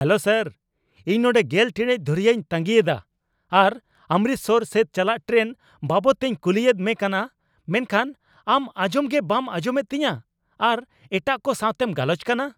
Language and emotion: Santali, angry